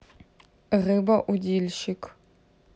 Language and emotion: Russian, neutral